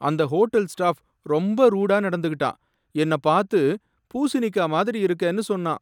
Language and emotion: Tamil, sad